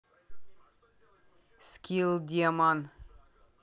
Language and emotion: Russian, neutral